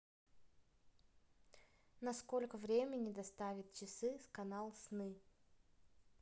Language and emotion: Russian, neutral